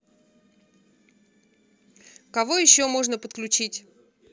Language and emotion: Russian, neutral